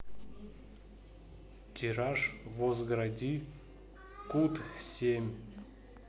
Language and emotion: Russian, neutral